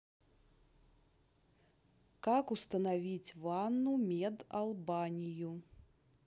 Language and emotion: Russian, neutral